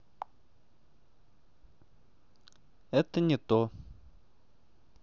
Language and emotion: Russian, neutral